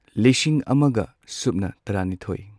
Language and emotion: Manipuri, neutral